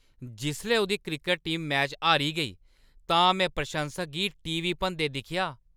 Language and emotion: Dogri, angry